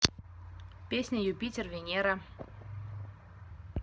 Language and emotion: Russian, neutral